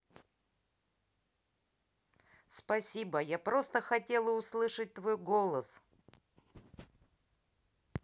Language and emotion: Russian, positive